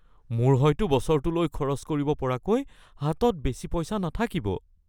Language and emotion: Assamese, fearful